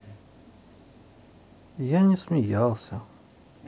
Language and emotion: Russian, neutral